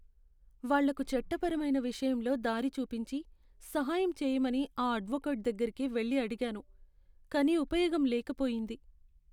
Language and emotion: Telugu, sad